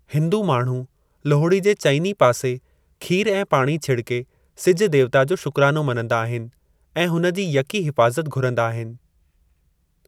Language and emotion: Sindhi, neutral